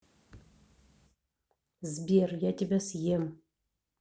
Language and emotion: Russian, neutral